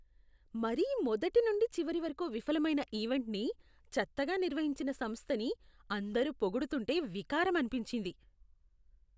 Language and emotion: Telugu, disgusted